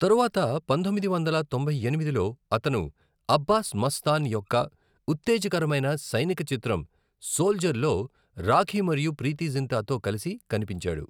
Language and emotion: Telugu, neutral